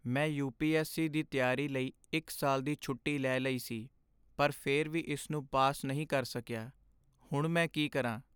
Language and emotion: Punjabi, sad